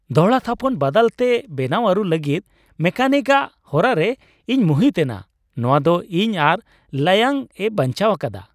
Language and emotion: Santali, happy